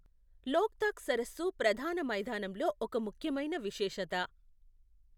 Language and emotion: Telugu, neutral